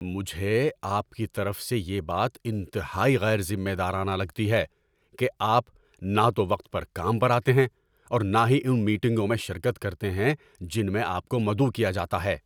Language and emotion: Urdu, angry